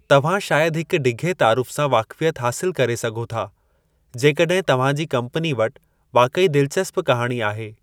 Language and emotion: Sindhi, neutral